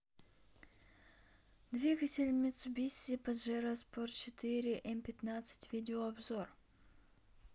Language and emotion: Russian, neutral